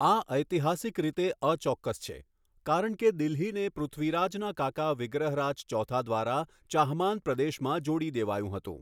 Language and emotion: Gujarati, neutral